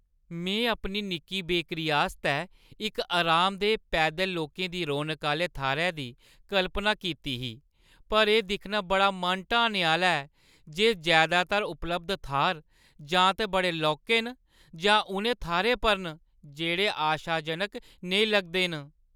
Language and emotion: Dogri, sad